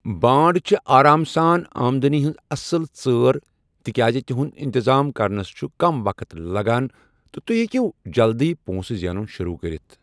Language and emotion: Kashmiri, neutral